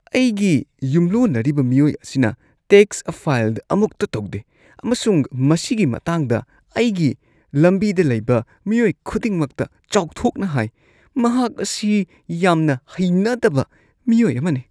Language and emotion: Manipuri, disgusted